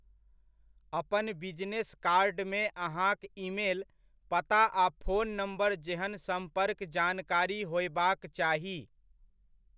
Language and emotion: Maithili, neutral